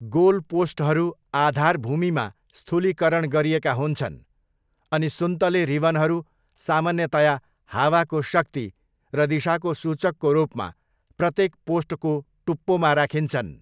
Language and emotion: Nepali, neutral